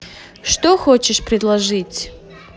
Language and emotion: Russian, neutral